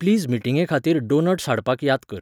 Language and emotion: Goan Konkani, neutral